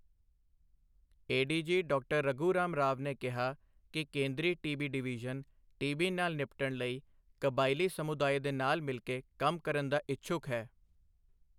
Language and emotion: Punjabi, neutral